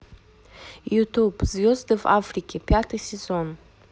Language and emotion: Russian, neutral